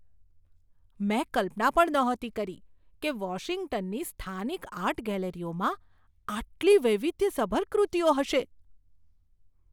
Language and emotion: Gujarati, surprised